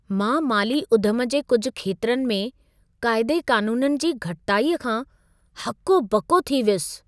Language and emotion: Sindhi, surprised